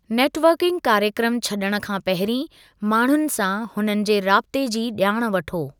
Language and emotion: Sindhi, neutral